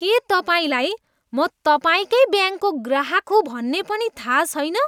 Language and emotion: Nepali, disgusted